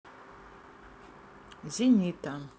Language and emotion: Russian, neutral